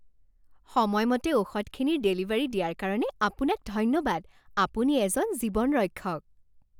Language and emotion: Assamese, happy